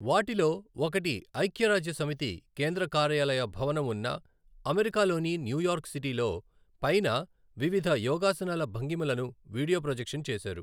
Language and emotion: Telugu, neutral